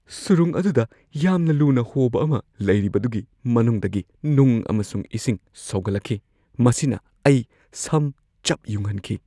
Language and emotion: Manipuri, fearful